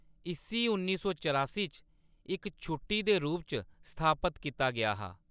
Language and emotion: Dogri, neutral